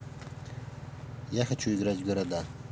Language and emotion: Russian, neutral